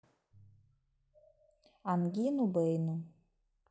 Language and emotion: Russian, neutral